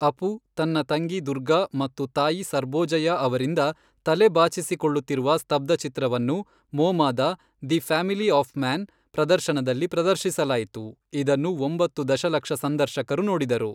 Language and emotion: Kannada, neutral